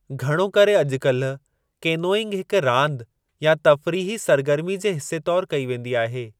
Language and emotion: Sindhi, neutral